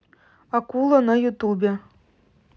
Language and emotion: Russian, neutral